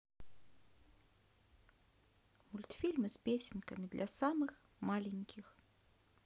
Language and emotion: Russian, neutral